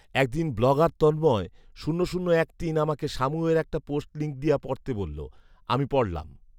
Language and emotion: Bengali, neutral